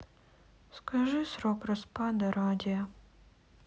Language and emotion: Russian, sad